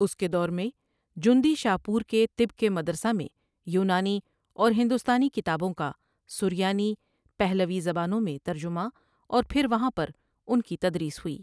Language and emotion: Urdu, neutral